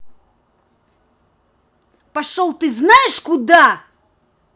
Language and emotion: Russian, angry